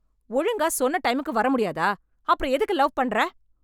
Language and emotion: Tamil, angry